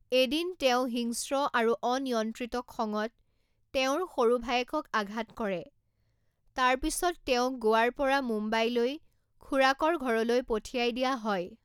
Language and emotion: Assamese, neutral